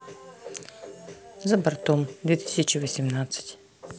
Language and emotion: Russian, neutral